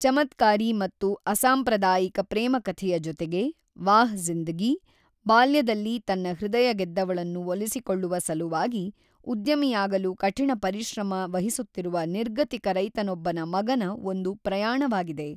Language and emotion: Kannada, neutral